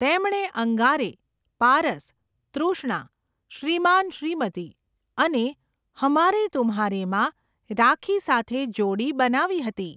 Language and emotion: Gujarati, neutral